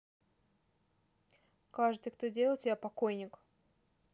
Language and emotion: Russian, angry